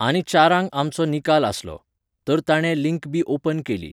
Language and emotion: Goan Konkani, neutral